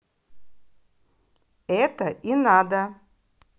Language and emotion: Russian, positive